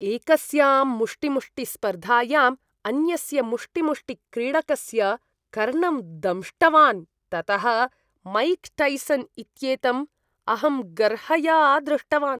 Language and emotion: Sanskrit, disgusted